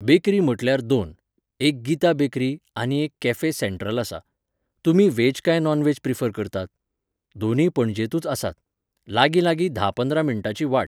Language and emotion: Goan Konkani, neutral